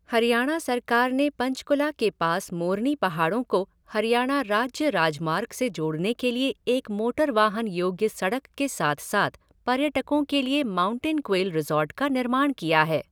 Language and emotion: Hindi, neutral